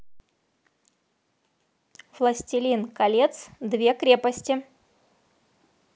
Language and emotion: Russian, positive